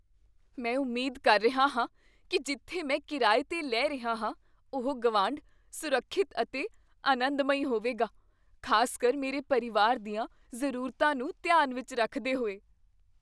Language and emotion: Punjabi, fearful